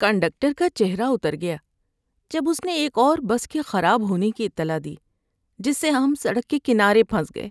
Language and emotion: Urdu, sad